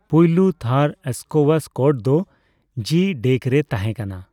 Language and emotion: Santali, neutral